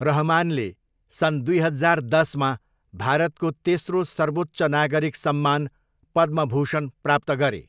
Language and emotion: Nepali, neutral